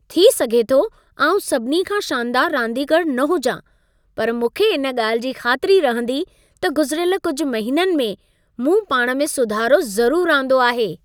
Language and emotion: Sindhi, happy